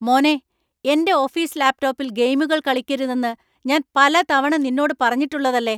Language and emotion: Malayalam, angry